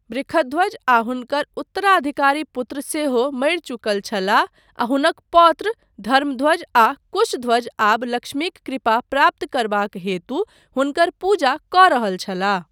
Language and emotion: Maithili, neutral